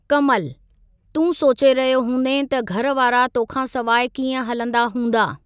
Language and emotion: Sindhi, neutral